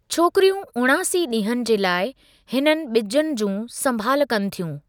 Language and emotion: Sindhi, neutral